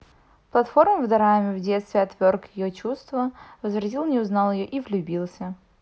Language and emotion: Russian, neutral